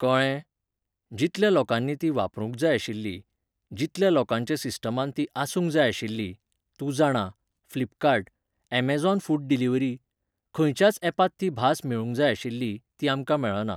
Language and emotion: Goan Konkani, neutral